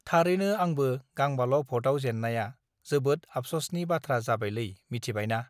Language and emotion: Bodo, neutral